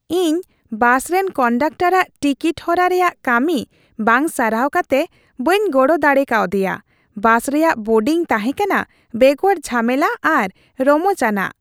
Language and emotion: Santali, happy